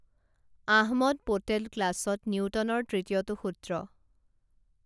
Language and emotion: Assamese, neutral